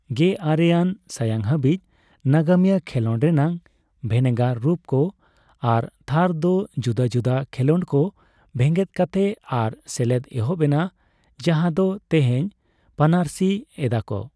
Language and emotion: Santali, neutral